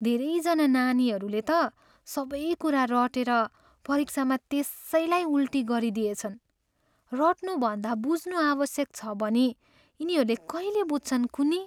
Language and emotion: Nepali, sad